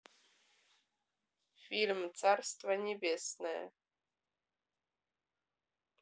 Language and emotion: Russian, neutral